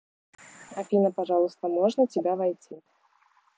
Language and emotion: Russian, neutral